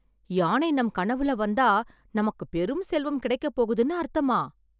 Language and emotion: Tamil, surprised